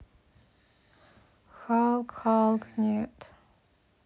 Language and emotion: Russian, sad